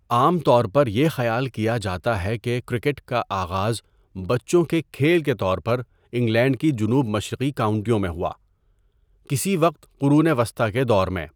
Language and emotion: Urdu, neutral